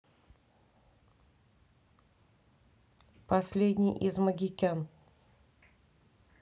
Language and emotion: Russian, neutral